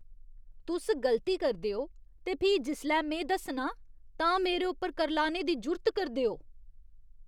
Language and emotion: Dogri, disgusted